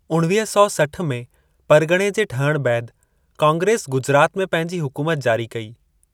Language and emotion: Sindhi, neutral